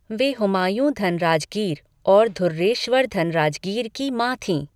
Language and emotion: Hindi, neutral